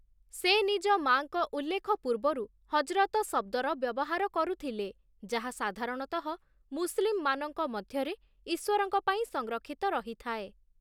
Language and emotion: Odia, neutral